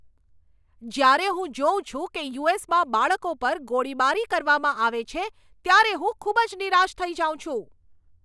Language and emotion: Gujarati, angry